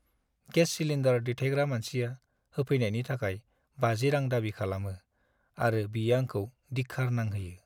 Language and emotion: Bodo, sad